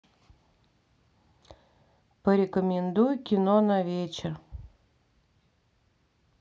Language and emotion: Russian, sad